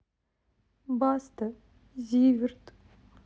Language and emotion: Russian, sad